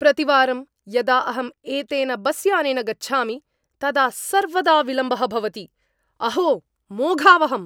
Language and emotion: Sanskrit, angry